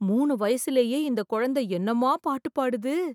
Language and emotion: Tamil, surprised